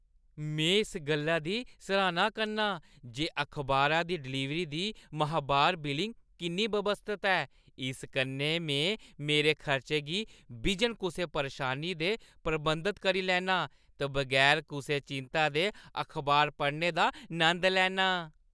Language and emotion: Dogri, happy